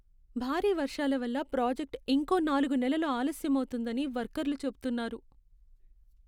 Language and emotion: Telugu, sad